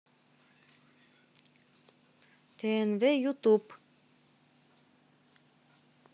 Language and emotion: Russian, neutral